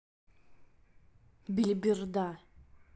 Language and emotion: Russian, angry